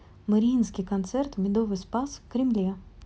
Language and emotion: Russian, neutral